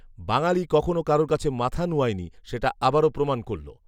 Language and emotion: Bengali, neutral